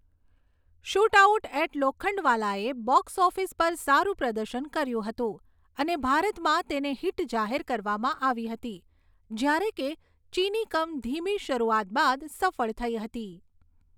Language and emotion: Gujarati, neutral